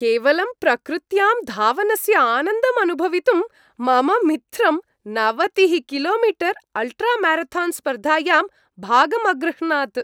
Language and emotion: Sanskrit, happy